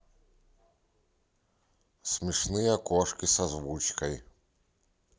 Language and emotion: Russian, neutral